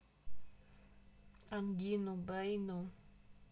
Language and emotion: Russian, neutral